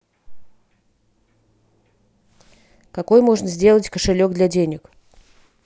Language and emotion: Russian, neutral